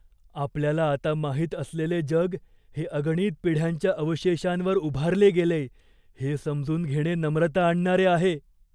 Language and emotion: Marathi, fearful